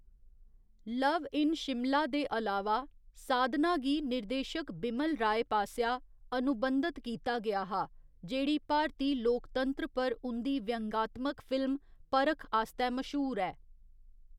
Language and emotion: Dogri, neutral